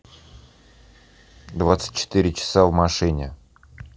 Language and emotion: Russian, neutral